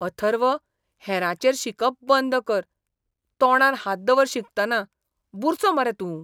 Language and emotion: Goan Konkani, disgusted